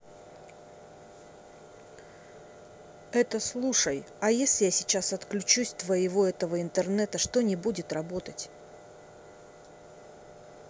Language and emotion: Russian, angry